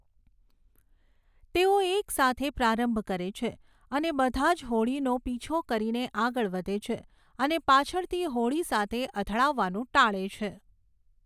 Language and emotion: Gujarati, neutral